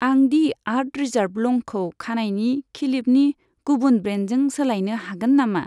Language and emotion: Bodo, neutral